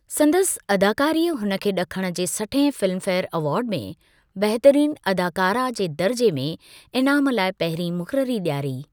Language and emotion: Sindhi, neutral